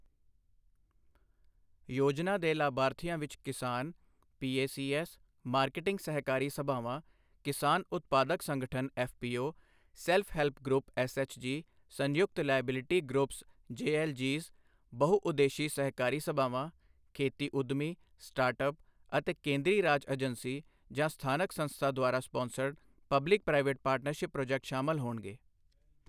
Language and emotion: Punjabi, neutral